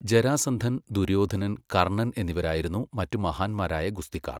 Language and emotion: Malayalam, neutral